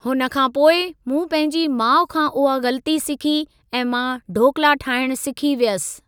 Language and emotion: Sindhi, neutral